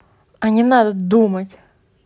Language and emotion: Russian, angry